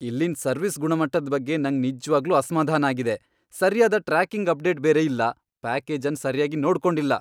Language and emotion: Kannada, angry